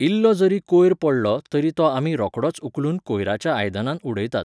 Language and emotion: Goan Konkani, neutral